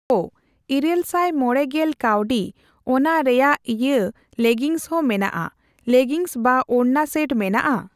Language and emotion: Santali, neutral